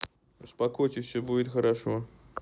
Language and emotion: Russian, neutral